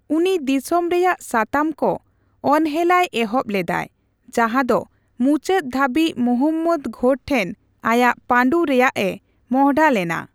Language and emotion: Santali, neutral